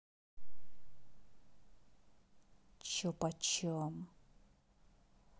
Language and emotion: Russian, angry